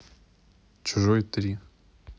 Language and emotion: Russian, neutral